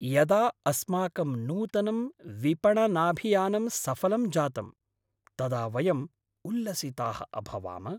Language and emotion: Sanskrit, happy